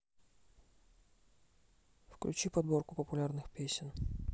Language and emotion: Russian, neutral